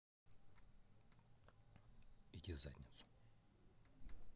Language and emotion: Russian, neutral